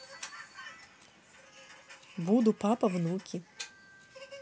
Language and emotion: Russian, neutral